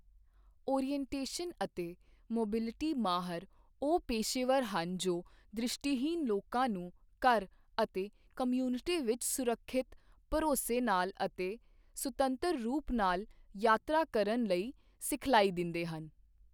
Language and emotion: Punjabi, neutral